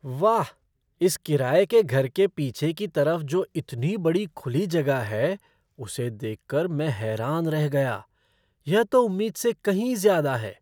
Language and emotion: Hindi, surprised